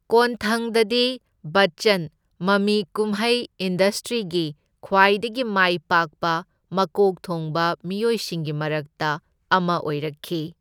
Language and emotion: Manipuri, neutral